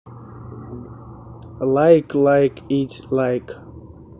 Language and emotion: Russian, neutral